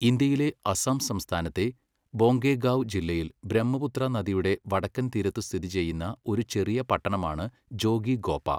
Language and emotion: Malayalam, neutral